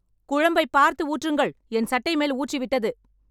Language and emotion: Tamil, angry